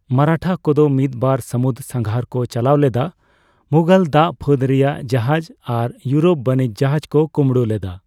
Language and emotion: Santali, neutral